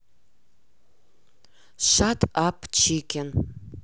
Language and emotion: Russian, neutral